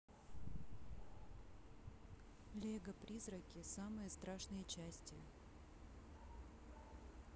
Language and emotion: Russian, neutral